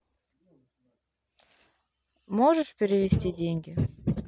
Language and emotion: Russian, neutral